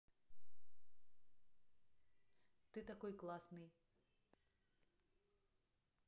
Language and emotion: Russian, neutral